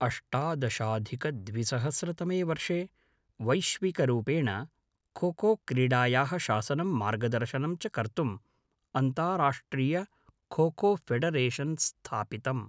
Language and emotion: Sanskrit, neutral